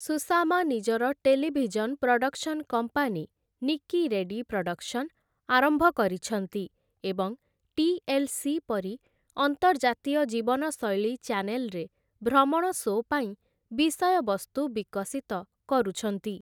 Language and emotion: Odia, neutral